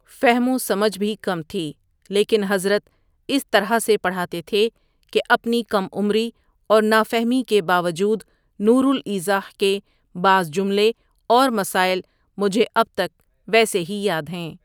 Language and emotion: Urdu, neutral